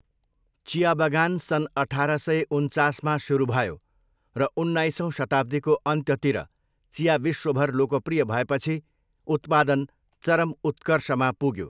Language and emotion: Nepali, neutral